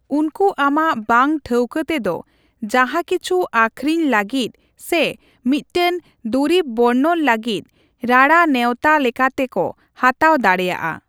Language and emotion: Santali, neutral